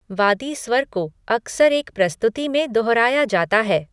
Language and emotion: Hindi, neutral